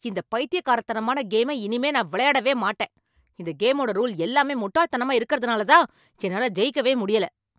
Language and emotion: Tamil, angry